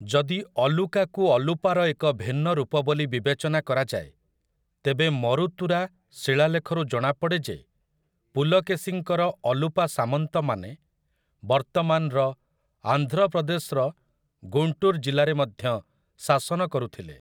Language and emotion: Odia, neutral